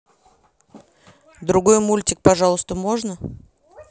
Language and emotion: Russian, neutral